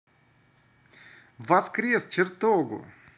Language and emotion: Russian, positive